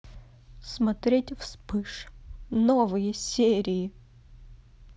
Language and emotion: Russian, sad